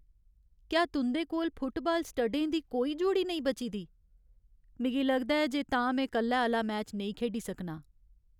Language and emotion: Dogri, sad